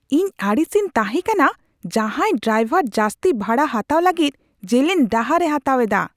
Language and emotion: Santali, angry